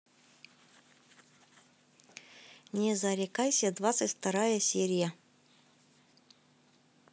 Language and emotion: Russian, neutral